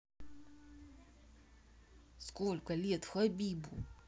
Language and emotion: Russian, neutral